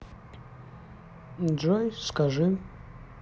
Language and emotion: Russian, neutral